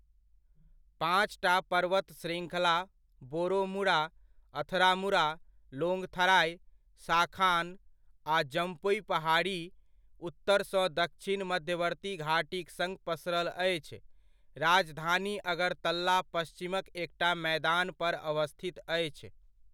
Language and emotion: Maithili, neutral